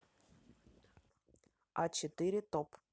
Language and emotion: Russian, neutral